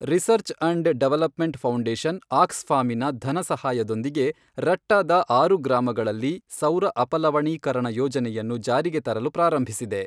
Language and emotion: Kannada, neutral